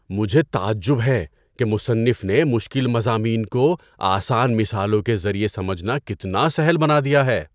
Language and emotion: Urdu, surprised